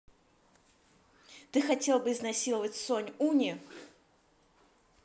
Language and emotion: Russian, neutral